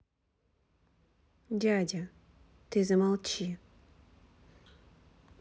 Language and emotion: Russian, neutral